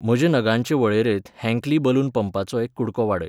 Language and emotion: Goan Konkani, neutral